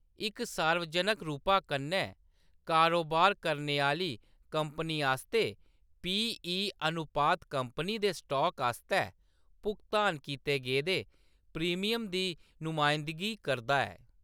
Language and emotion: Dogri, neutral